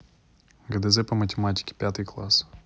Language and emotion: Russian, neutral